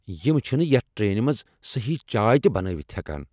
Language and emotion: Kashmiri, angry